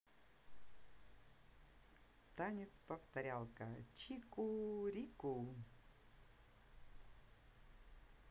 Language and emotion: Russian, positive